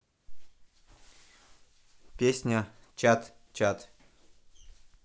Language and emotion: Russian, neutral